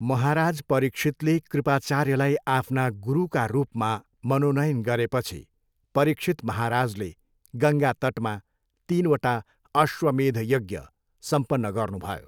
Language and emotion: Nepali, neutral